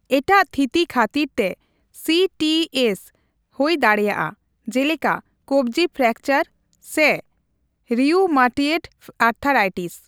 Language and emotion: Santali, neutral